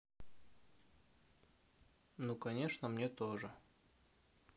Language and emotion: Russian, neutral